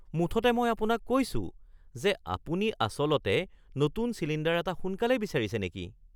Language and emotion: Assamese, surprised